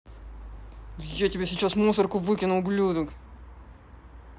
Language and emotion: Russian, angry